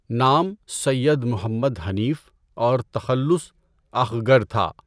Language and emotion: Urdu, neutral